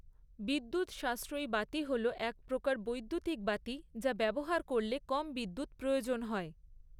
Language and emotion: Bengali, neutral